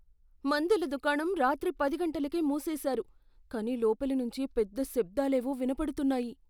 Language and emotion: Telugu, fearful